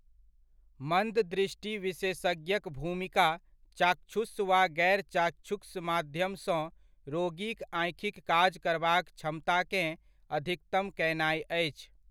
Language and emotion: Maithili, neutral